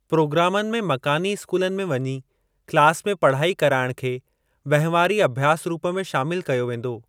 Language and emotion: Sindhi, neutral